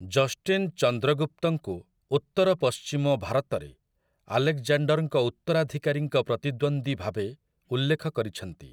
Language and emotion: Odia, neutral